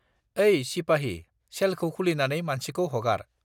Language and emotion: Bodo, neutral